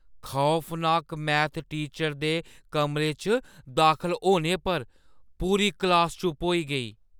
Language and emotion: Dogri, fearful